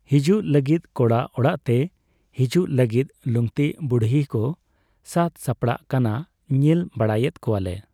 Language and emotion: Santali, neutral